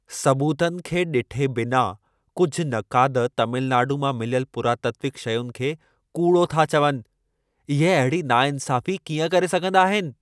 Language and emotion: Sindhi, angry